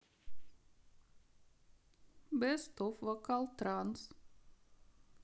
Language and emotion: Russian, sad